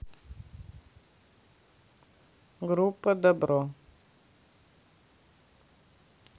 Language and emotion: Russian, neutral